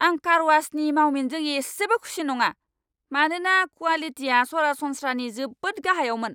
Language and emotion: Bodo, angry